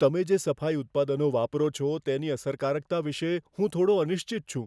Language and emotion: Gujarati, fearful